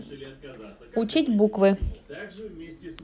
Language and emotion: Russian, neutral